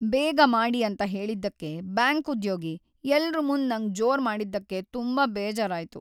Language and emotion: Kannada, sad